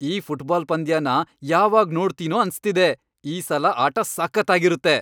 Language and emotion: Kannada, happy